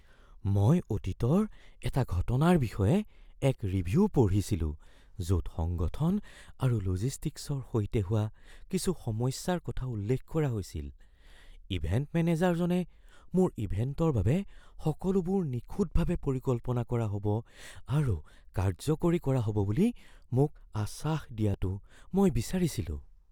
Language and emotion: Assamese, fearful